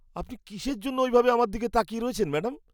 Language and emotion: Bengali, disgusted